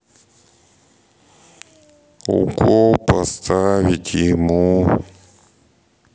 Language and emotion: Russian, sad